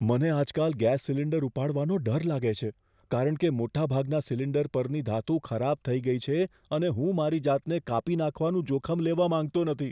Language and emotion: Gujarati, fearful